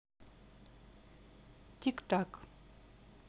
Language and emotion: Russian, neutral